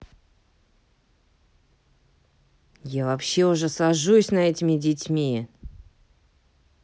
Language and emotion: Russian, angry